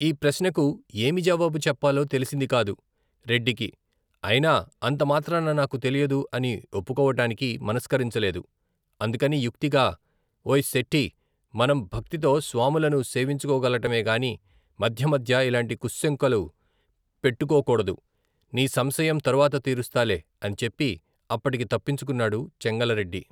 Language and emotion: Telugu, neutral